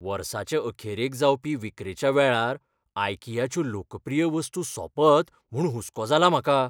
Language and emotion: Goan Konkani, fearful